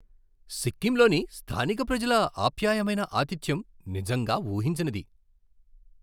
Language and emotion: Telugu, surprised